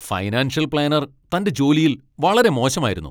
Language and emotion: Malayalam, angry